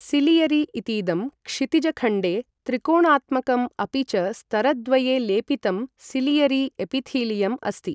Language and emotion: Sanskrit, neutral